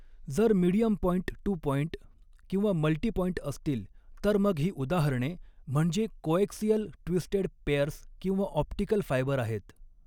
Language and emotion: Marathi, neutral